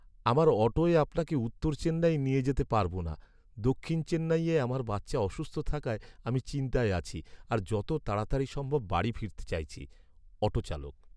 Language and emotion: Bengali, sad